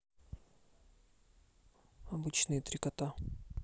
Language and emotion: Russian, neutral